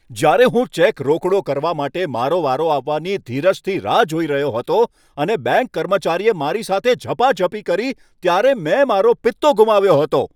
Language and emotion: Gujarati, angry